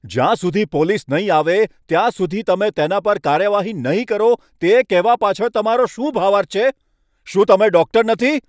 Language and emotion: Gujarati, angry